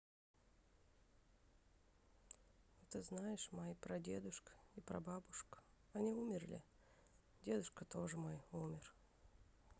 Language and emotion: Russian, sad